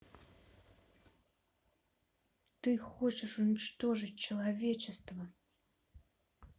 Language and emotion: Russian, neutral